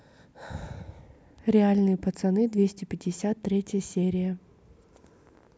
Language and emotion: Russian, neutral